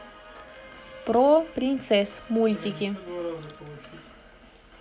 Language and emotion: Russian, neutral